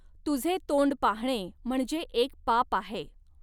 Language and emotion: Marathi, neutral